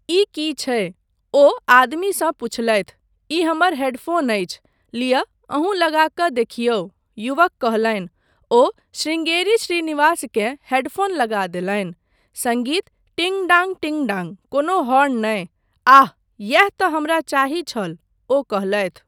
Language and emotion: Maithili, neutral